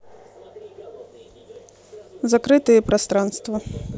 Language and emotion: Russian, neutral